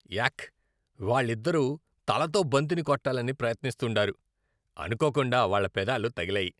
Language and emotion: Telugu, disgusted